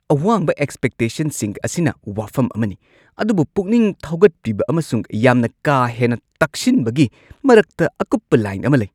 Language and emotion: Manipuri, angry